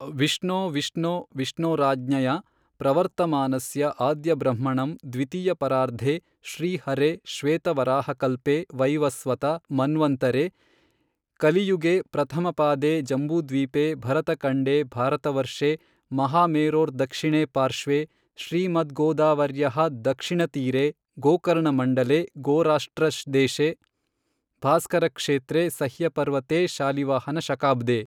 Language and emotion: Kannada, neutral